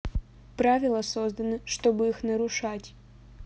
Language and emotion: Russian, neutral